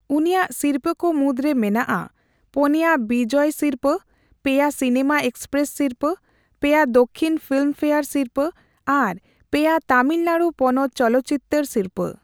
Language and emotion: Santali, neutral